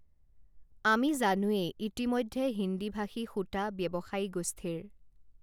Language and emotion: Assamese, neutral